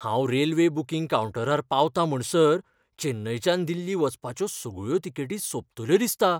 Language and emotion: Goan Konkani, fearful